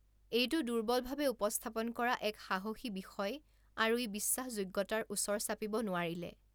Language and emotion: Assamese, neutral